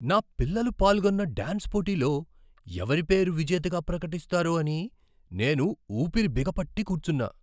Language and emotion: Telugu, surprised